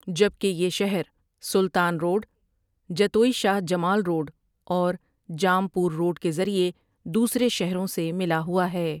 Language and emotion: Urdu, neutral